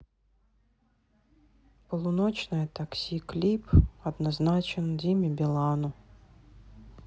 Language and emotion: Russian, sad